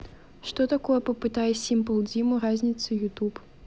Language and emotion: Russian, neutral